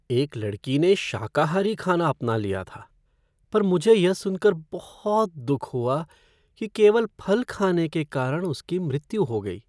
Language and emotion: Hindi, sad